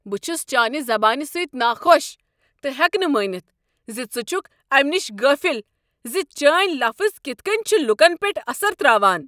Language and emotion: Kashmiri, angry